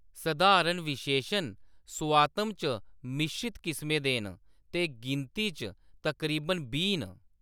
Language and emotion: Dogri, neutral